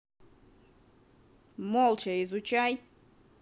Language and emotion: Russian, angry